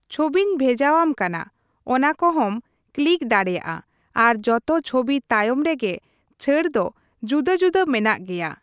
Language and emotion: Santali, neutral